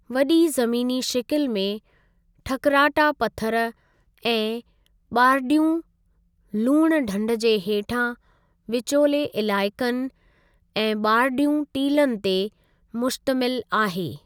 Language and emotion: Sindhi, neutral